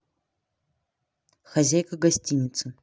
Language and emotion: Russian, neutral